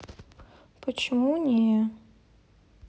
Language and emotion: Russian, sad